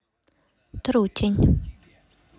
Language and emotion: Russian, neutral